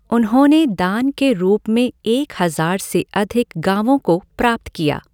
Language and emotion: Hindi, neutral